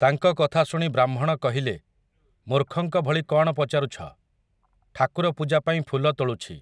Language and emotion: Odia, neutral